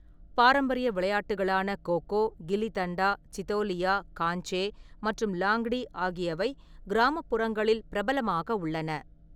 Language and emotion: Tamil, neutral